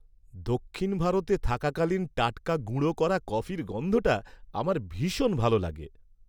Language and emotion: Bengali, happy